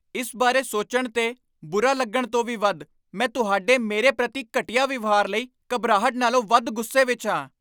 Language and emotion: Punjabi, angry